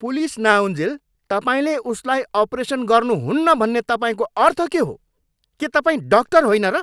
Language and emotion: Nepali, angry